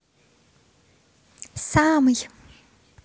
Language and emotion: Russian, positive